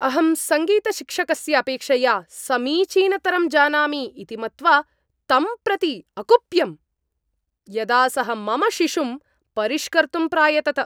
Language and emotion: Sanskrit, angry